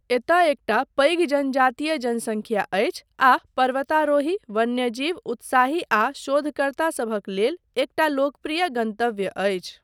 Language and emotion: Maithili, neutral